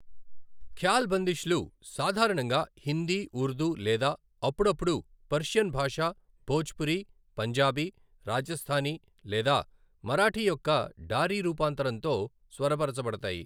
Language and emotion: Telugu, neutral